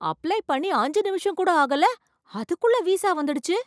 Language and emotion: Tamil, surprised